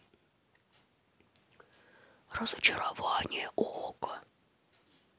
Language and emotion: Russian, neutral